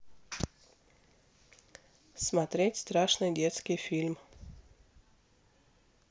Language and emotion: Russian, neutral